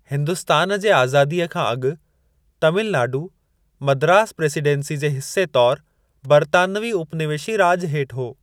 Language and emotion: Sindhi, neutral